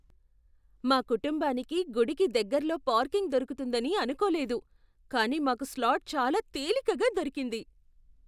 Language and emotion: Telugu, surprised